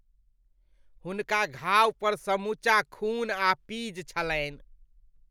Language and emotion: Maithili, disgusted